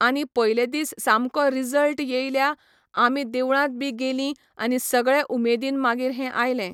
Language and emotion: Goan Konkani, neutral